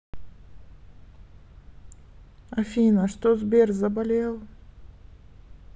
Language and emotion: Russian, sad